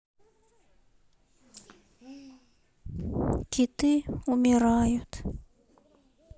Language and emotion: Russian, sad